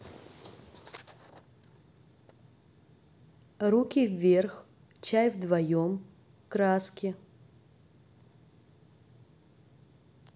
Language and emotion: Russian, neutral